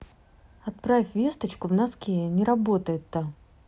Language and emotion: Russian, neutral